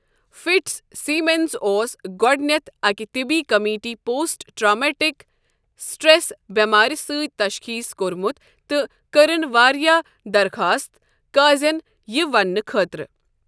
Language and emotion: Kashmiri, neutral